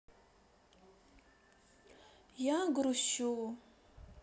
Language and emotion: Russian, sad